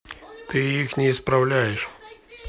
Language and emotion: Russian, neutral